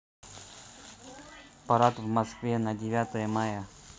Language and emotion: Russian, neutral